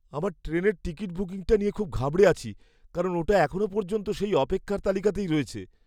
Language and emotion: Bengali, fearful